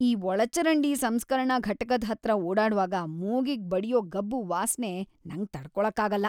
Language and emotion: Kannada, disgusted